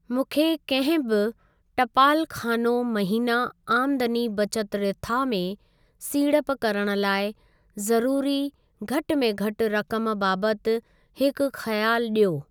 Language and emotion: Sindhi, neutral